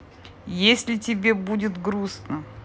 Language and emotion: Russian, neutral